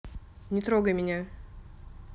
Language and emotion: Russian, angry